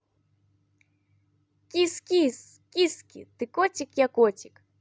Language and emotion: Russian, positive